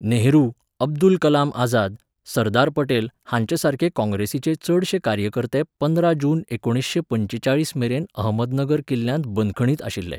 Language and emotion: Goan Konkani, neutral